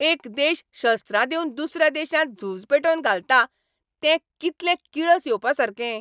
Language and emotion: Goan Konkani, angry